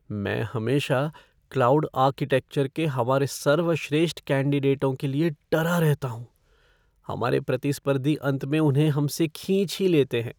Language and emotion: Hindi, fearful